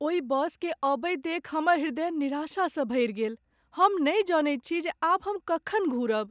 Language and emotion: Maithili, sad